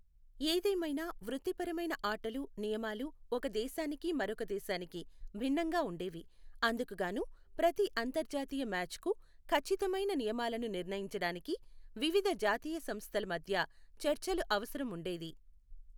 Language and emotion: Telugu, neutral